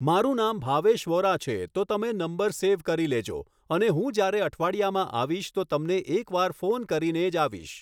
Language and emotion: Gujarati, neutral